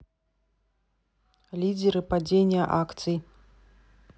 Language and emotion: Russian, neutral